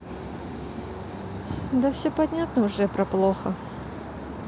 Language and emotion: Russian, sad